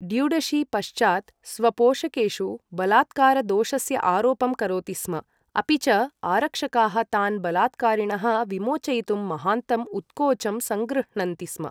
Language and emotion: Sanskrit, neutral